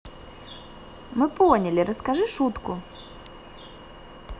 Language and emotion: Russian, positive